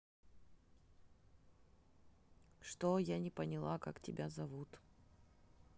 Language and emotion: Russian, neutral